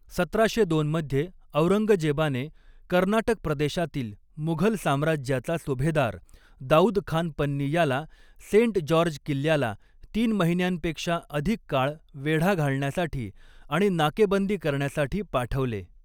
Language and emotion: Marathi, neutral